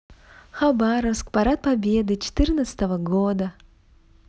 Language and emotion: Russian, positive